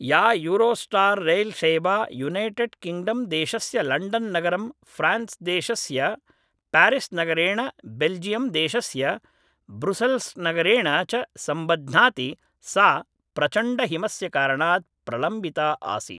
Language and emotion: Sanskrit, neutral